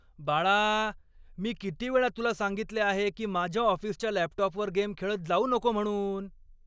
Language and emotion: Marathi, angry